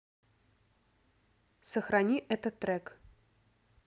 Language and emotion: Russian, neutral